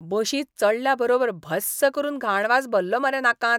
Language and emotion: Goan Konkani, disgusted